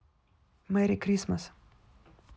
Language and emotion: Russian, neutral